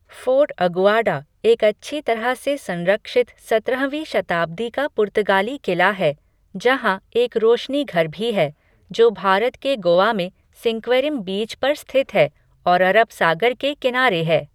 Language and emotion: Hindi, neutral